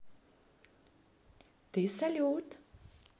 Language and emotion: Russian, positive